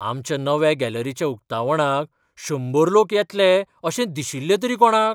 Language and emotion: Goan Konkani, surprised